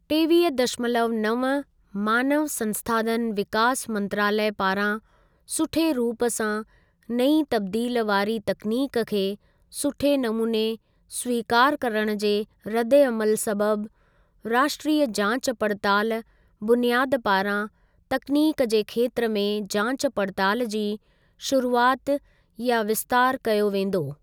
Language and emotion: Sindhi, neutral